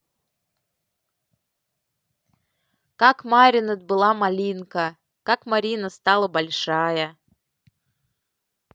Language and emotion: Russian, neutral